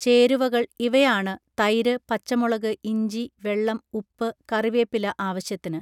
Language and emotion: Malayalam, neutral